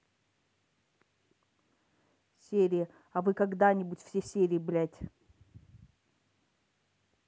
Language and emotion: Russian, neutral